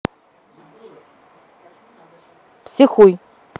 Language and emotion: Russian, neutral